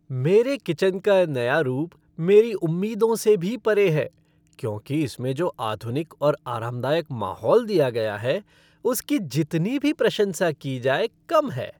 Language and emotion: Hindi, happy